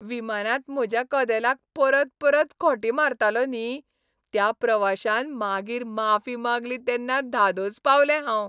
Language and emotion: Goan Konkani, happy